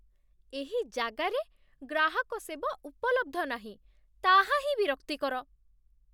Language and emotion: Odia, disgusted